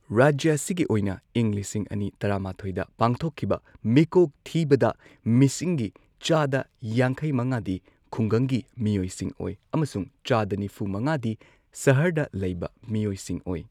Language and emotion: Manipuri, neutral